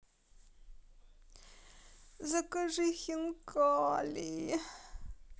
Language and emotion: Russian, sad